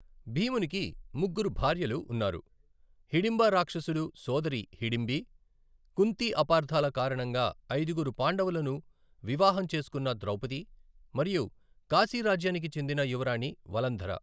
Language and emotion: Telugu, neutral